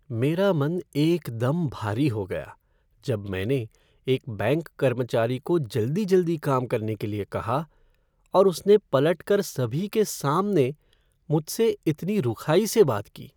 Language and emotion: Hindi, sad